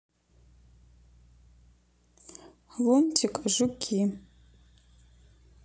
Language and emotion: Russian, neutral